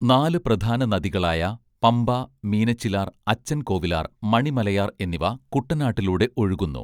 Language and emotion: Malayalam, neutral